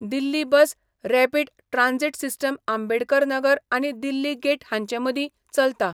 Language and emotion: Goan Konkani, neutral